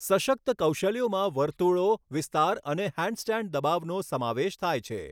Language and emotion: Gujarati, neutral